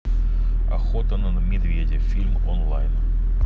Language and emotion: Russian, neutral